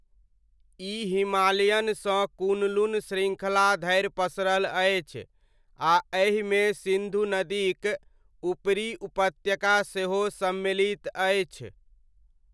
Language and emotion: Maithili, neutral